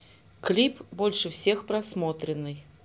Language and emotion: Russian, neutral